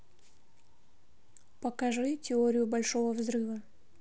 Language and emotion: Russian, neutral